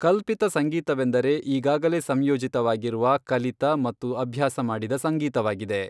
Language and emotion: Kannada, neutral